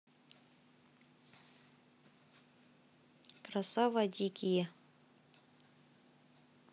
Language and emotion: Russian, neutral